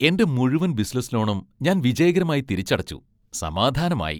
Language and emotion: Malayalam, happy